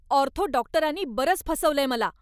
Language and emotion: Marathi, angry